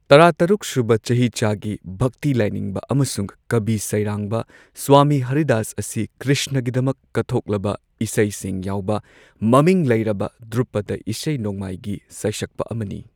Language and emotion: Manipuri, neutral